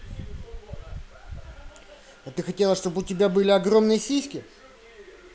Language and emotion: Russian, angry